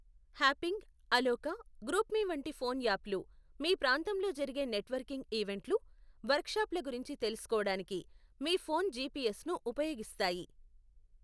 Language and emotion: Telugu, neutral